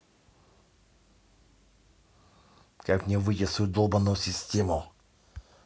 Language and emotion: Russian, angry